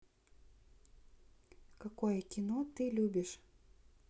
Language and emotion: Russian, neutral